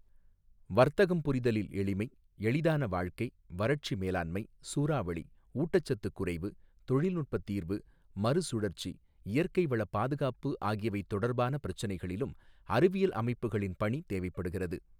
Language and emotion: Tamil, neutral